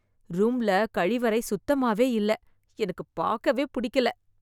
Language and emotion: Tamil, disgusted